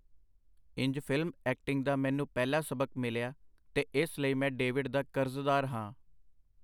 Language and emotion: Punjabi, neutral